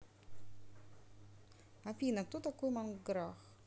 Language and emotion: Russian, neutral